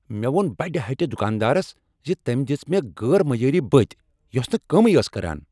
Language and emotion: Kashmiri, angry